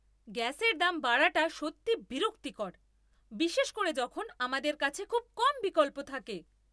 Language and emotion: Bengali, angry